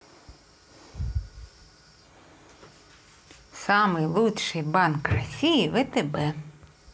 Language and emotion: Russian, positive